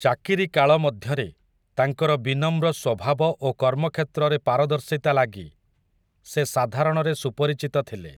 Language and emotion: Odia, neutral